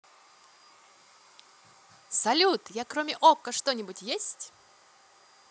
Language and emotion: Russian, positive